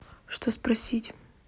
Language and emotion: Russian, neutral